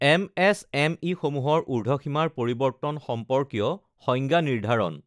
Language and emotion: Assamese, neutral